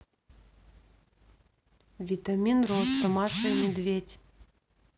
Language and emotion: Russian, neutral